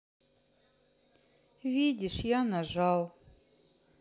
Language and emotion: Russian, sad